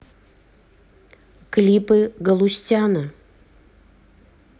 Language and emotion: Russian, neutral